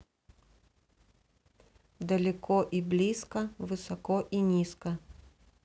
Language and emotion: Russian, neutral